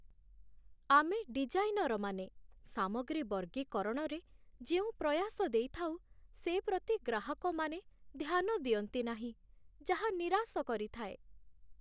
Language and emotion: Odia, sad